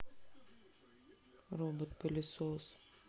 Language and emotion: Russian, sad